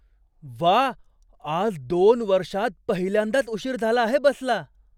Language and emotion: Marathi, surprised